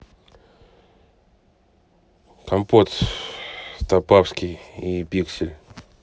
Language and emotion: Russian, neutral